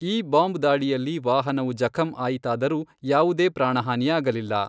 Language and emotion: Kannada, neutral